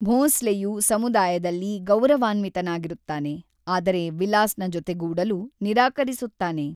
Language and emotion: Kannada, neutral